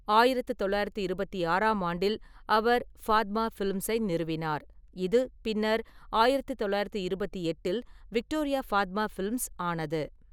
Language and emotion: Tamil, neutral